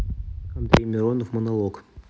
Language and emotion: Russian, neutral